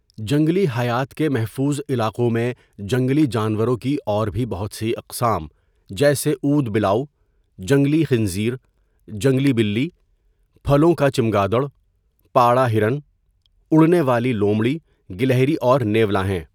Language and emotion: Urdu, neutral